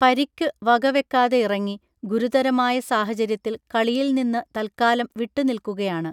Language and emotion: Malayalam, neutral